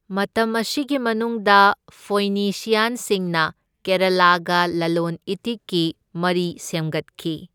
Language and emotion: Manipuri, neutral